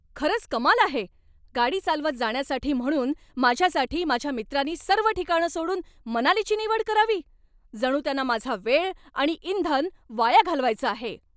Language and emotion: Marathi, angry